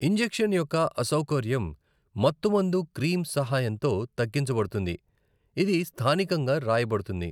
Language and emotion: Telugu, neutral